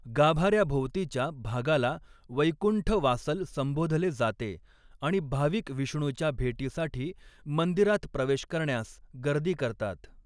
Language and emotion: Marathi, neutral